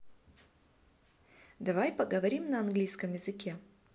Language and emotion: Russian, neutral